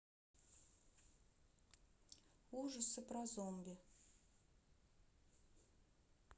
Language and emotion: Russian, neutral